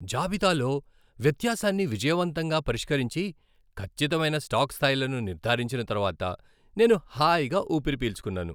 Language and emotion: Telugu, happy